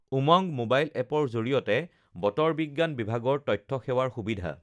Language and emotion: Assamese, neutral